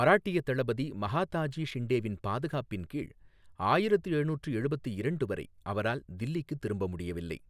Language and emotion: Tamil, neutral